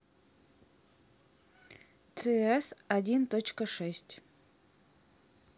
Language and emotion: Russian, neutral